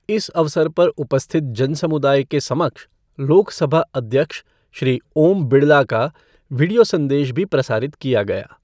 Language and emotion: Hindi, neutral